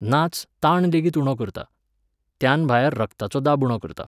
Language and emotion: Goan Konkani, neutral